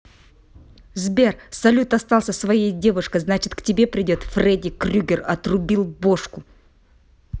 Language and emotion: Russian, angry